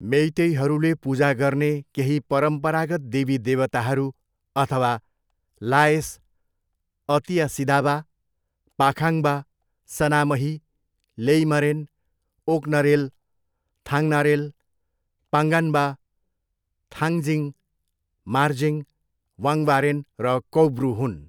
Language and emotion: Nepali, neutral